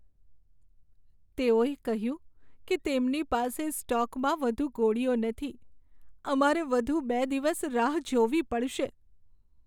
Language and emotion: Gujarati, sad